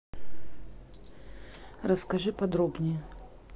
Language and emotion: Russian, neutral